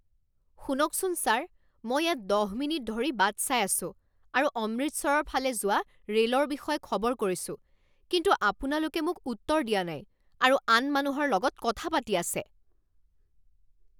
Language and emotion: Assamese, angry